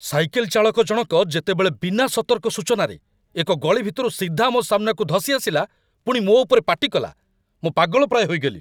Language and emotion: Odia, angry